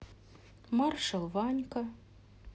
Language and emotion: Russian, sad